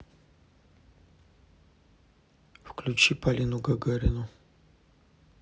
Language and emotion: Russian, neutral